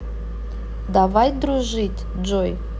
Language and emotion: Russian, neutral